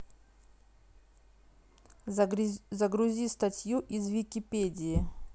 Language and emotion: Russian, neutral